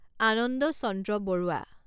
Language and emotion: Assamese, neutral